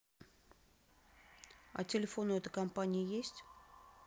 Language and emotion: Russian, neutral